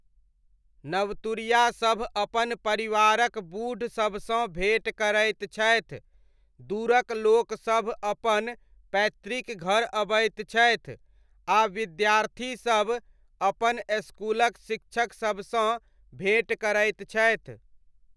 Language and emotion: Maithili, neutral